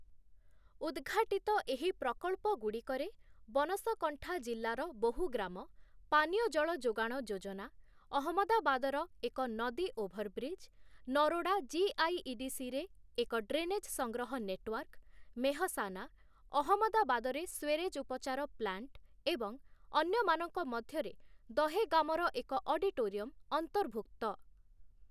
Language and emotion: Odia, neutral